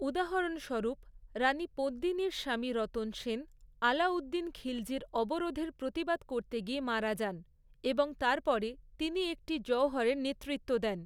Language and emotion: Bengali, neutral